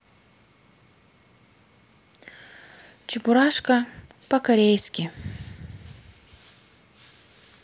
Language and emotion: Russian, neutral